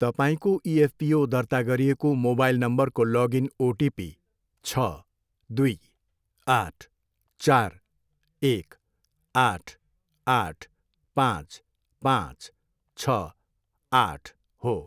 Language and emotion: Nepali, neutral